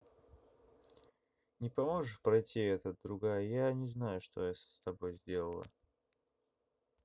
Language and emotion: Russian, neutral